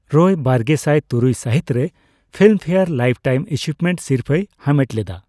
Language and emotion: Santali, neutral